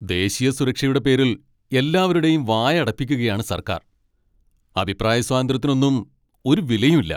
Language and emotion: Malayalam, angry